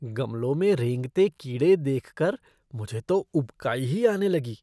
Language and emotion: Hindi, disgusted